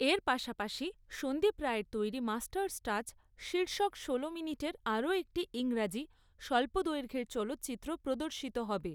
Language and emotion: Bengali, neutral